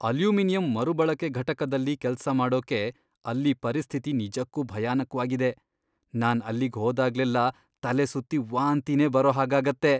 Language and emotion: Kannada, disgusted